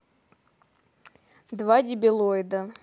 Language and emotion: Russian, neutral